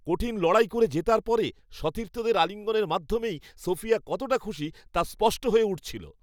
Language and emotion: Bengali, happy